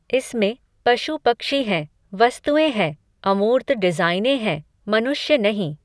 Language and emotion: Hindi, neutral